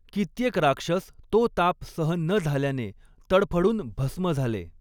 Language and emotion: Marathi, neutral